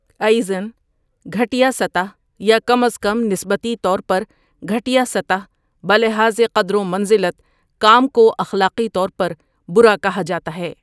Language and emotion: Urdu, neutral